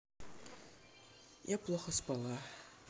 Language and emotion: Russian, sad